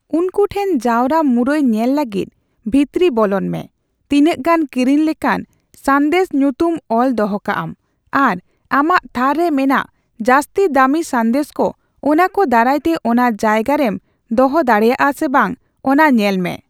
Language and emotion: Santali, neutral